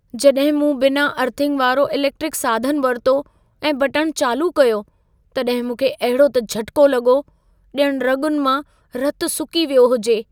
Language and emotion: Sindhi, fearful